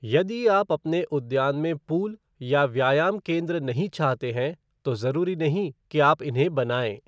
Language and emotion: Hindi, neutral